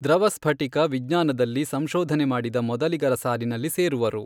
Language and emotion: Kannada, neutral